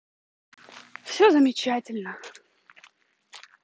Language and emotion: Russian, neutral